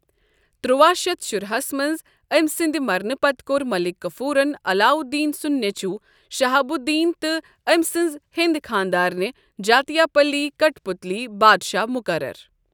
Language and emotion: Kashmiri, neutral